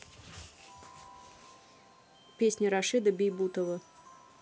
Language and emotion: Russian, neutral